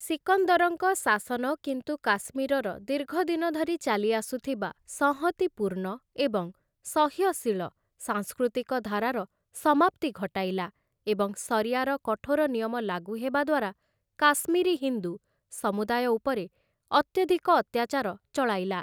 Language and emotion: Odia, neutral